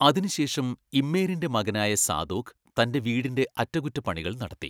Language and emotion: Malayalam, neutral